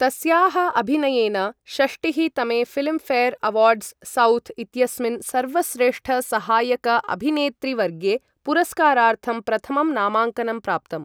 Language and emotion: Sanskrit, neutral